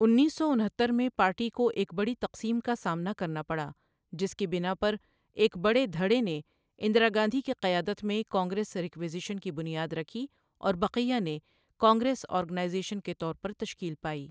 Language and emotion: Urdu, neutral